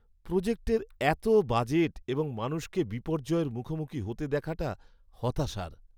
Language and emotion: Bengali, sad